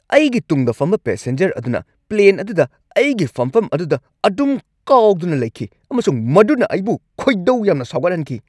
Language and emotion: Manipuri, angry